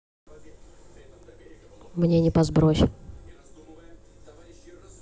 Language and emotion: Russian, neutral